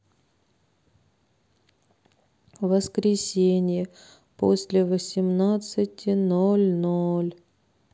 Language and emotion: Russian, sad